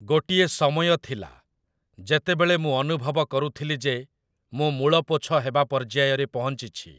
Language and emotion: Odia, neutral